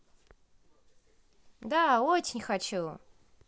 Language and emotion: Russian, positive